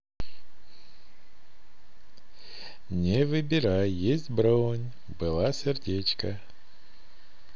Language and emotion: Russian, positive